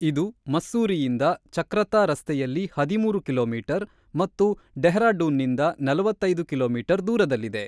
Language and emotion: Kannada, neutral